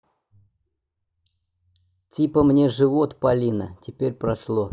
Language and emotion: Russian, neutral